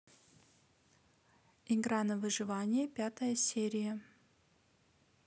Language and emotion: Russian, neutral